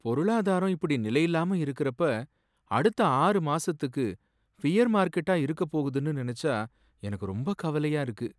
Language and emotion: Tamil, sad